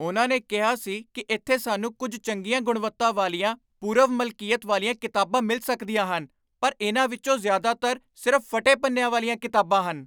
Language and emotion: Punjabi, angry